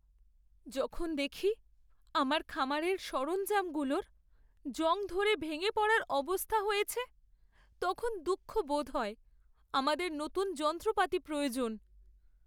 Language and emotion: Bengali, sad